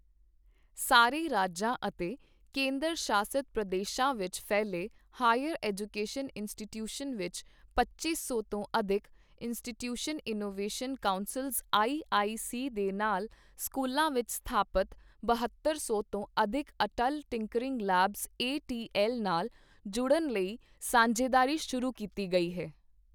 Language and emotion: Punjabi, neutral